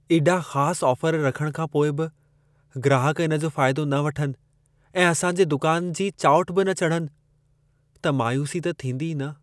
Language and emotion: Sindhi, sad